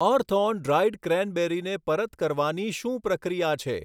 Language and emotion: Gujarati, neutral